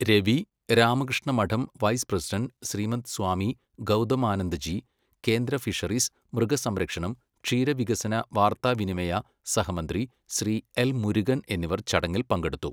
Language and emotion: Malayalam, neutral